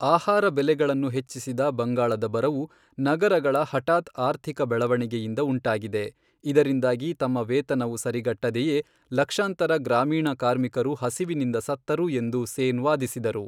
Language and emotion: Kannada, neutral